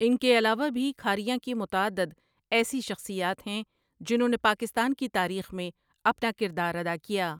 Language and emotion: Urdu, neutral